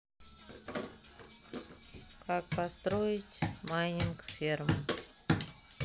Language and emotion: Russian, neutral